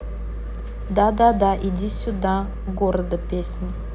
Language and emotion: Russian, neutral